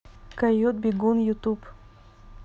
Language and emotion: Russian, neutral